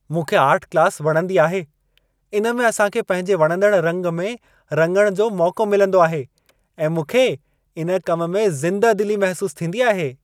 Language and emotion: Sindhi, happy